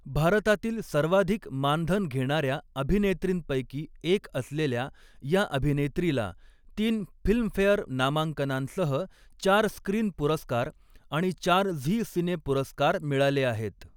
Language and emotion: Marathi, neutral